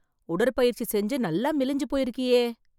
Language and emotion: Tamil, surprised